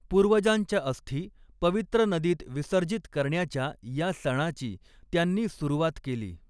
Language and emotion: Marathi, neutral